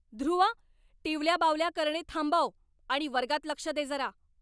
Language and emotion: Marathi, angry